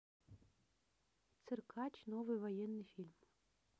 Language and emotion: Russian, neutral